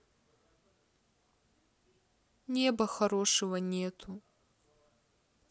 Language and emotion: Russian, sad